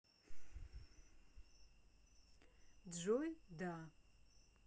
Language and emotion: Russian, positive